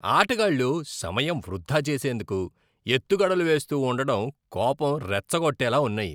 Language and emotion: Telugu, disgusted